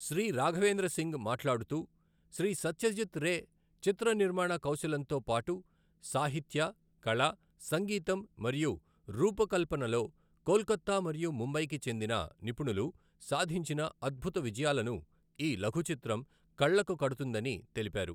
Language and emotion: Telugu, neutral